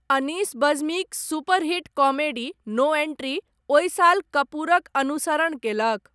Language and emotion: Maithili, neutral